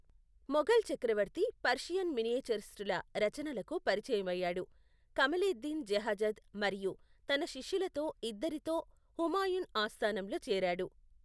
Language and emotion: Telugu, neutral